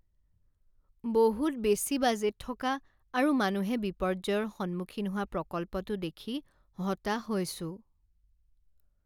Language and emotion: Assamese, sad